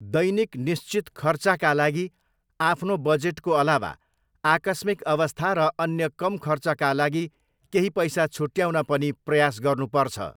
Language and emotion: Nepali, neutral